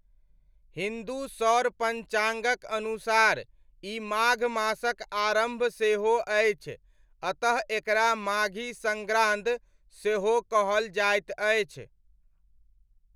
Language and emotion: Maithili, neutral